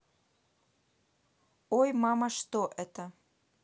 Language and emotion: Russian, neutral